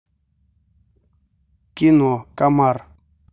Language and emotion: Russian, neutral